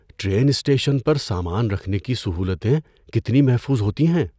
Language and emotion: Urdu, fearful